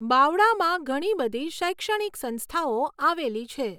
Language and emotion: Gujarati, neutral